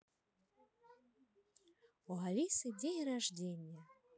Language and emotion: Russian, positive